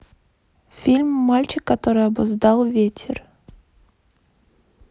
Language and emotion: Russian, neutral